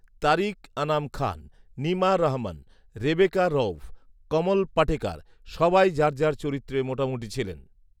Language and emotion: Bengali, neutral